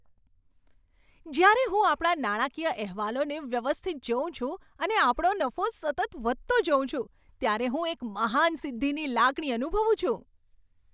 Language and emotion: Gujarati, happy